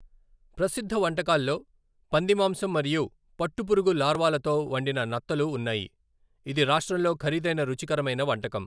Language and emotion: Telugu, neutral